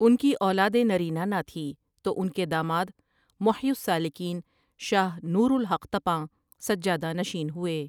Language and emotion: Urdu, neutral